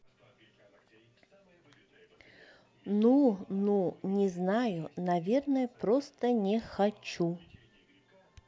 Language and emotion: Russian, neutral